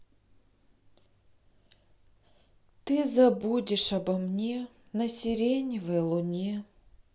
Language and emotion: Russian, sad